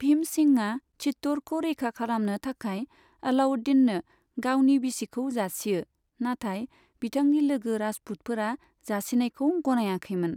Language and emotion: Bodo, neutral